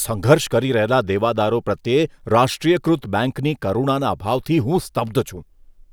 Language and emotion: Gujarati, disgusted